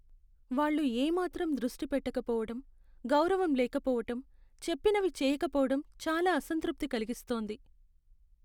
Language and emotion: Telugu, sad